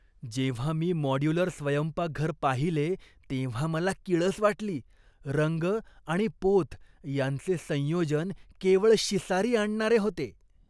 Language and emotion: Marathi, disgusted